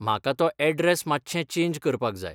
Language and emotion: Goan Konkani, neutral